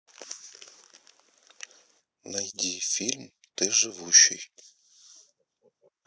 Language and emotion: Russian, neutral